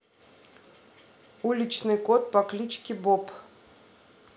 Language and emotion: Russian, neutral